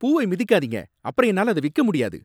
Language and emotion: Tamil, angry